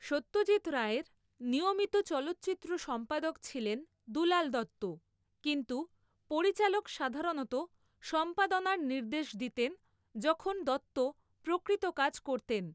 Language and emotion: Bengali, neutral